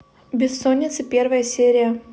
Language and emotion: Russian, neutral